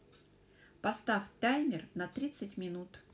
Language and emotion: Russian, neutral